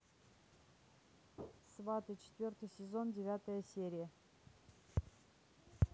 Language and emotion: Russian, neutral